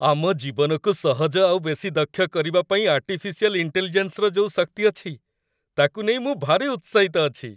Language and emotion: Odia, happy